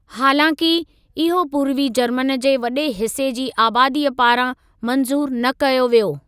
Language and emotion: Sindhi, neutral